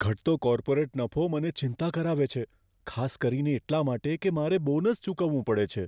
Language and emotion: Gujarati, fearful